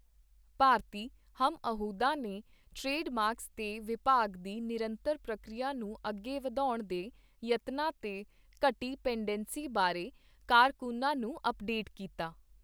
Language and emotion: Punjabi, neutral